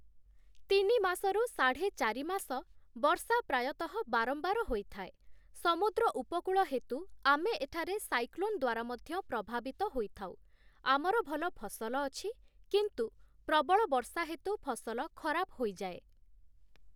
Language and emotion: Odia, neutral